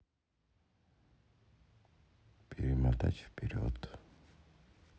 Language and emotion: Russian, sad